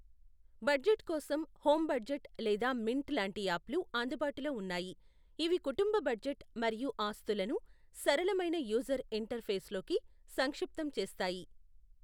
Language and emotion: Telugu, neutral